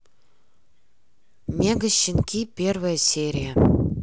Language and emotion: Russian, neutral